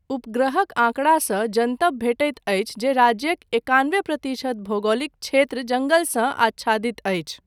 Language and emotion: Maithili, neutral